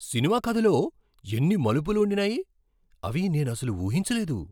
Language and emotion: Telugu, surprised